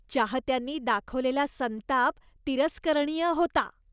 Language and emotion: Marathi, disgusted